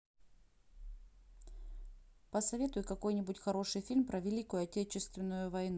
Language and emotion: Russian, neutral